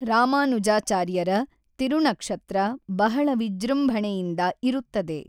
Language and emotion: Kannada, neutral